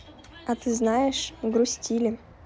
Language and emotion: Russian, neutral